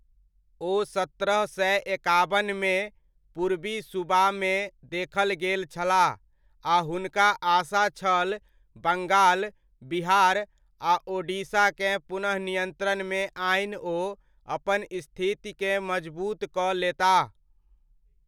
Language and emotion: Maithili, neutral